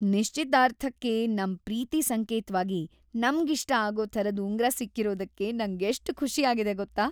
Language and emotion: Kannada, happy